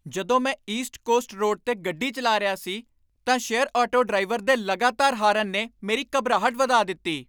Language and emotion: Punjabi, angry